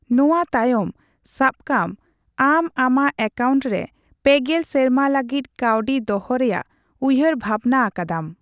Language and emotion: Santali, neutral